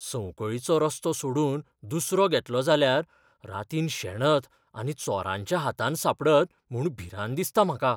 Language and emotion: Goan Konkani, fearful